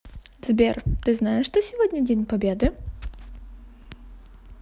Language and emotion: Russian, positive